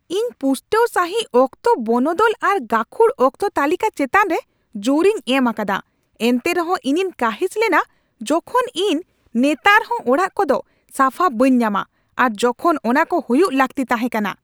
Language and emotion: Santali, angry